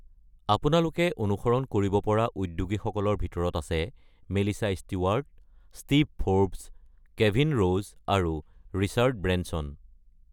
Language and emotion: Assamese, neutral